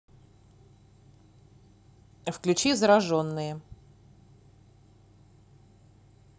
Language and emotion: Russian, neutral